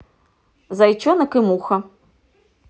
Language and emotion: Russian, neutral